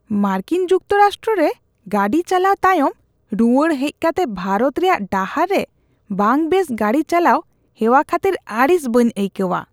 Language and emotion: Santali, disgusted